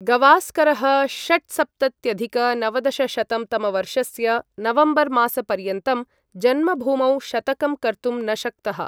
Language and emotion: Sanskrit, neutral